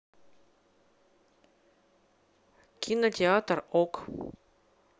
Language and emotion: Russian, neutral